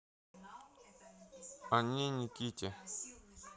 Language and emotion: Russian, neutral